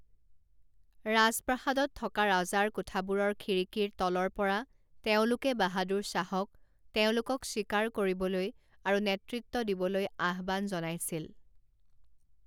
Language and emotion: Assamese, neutral